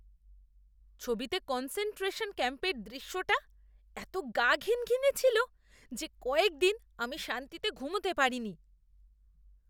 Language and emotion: Bengali, disgusted